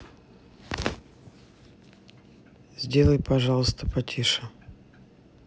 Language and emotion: Russian, neutral